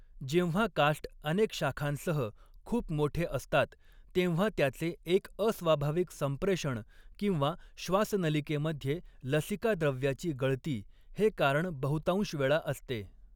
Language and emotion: Marathi, neutral